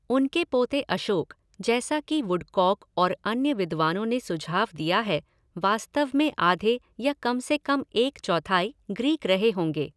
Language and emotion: Hindi, neutral